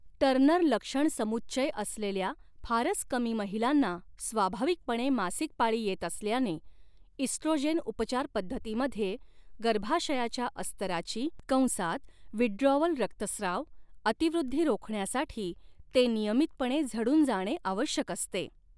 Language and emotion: Marathi, neutral